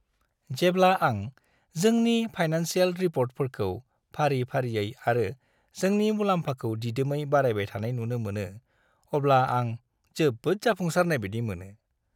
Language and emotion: Bodo, happy